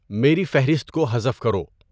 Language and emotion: Urdu, neutral